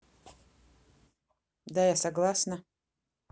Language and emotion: Russian, neutral